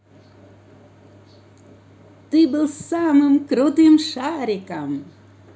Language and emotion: Russian, positive